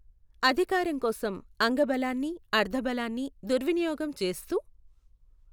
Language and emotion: Telugu, neutral